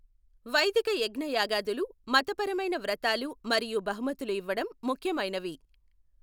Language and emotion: Telugu, neutral